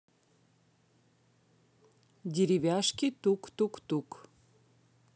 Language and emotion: Russian, neutral